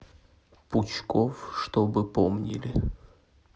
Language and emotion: Russian, sad